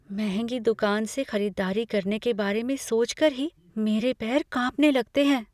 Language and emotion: Hindi, fearful